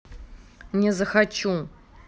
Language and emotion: Russian, angry